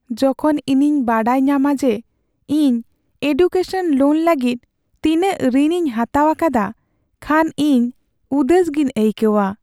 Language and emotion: Santali, sad